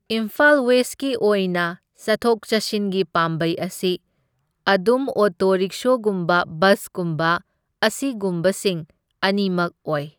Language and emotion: Manipuri, neutral